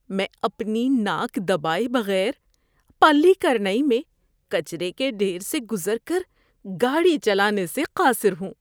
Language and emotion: Urdu, disgusted